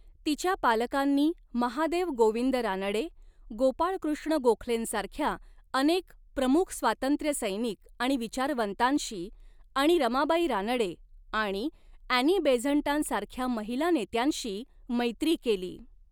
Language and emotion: Marathi, neutral